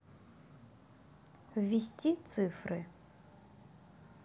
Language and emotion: Russian, neutral